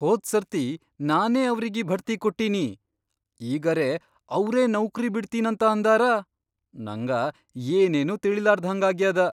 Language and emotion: Kannada, surprised